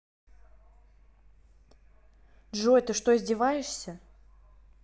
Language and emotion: Russian, angry